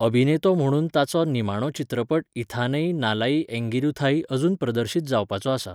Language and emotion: Goan Konkani, neutral